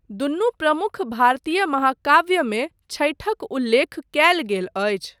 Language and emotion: Maithili, neutral